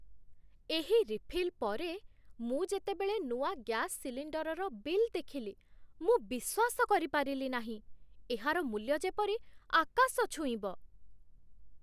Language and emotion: Odia, surprised